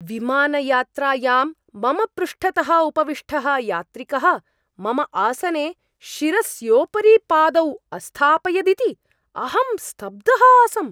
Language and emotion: Sanskrit, surprised